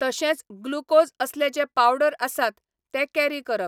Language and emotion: Goan Konkani, neutral